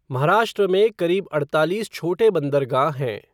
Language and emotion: Hindi, neutral